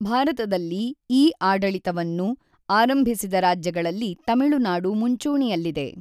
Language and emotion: Kannada, neutral